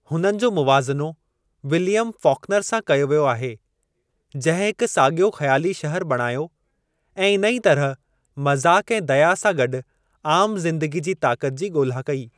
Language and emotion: Sindhi, neutral